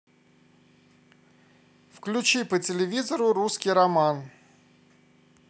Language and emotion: Russian, positive